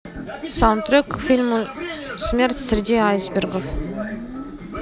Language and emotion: Russian, neutral